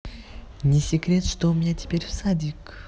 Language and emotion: Russian, positive